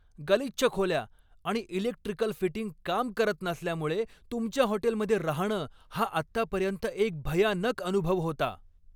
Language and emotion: Marathi, angry